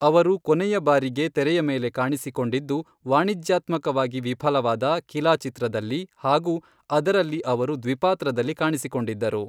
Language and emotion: Kannada, neutral